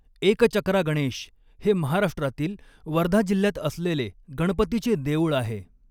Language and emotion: Marathi, neutral